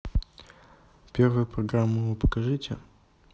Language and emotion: Russian, neutral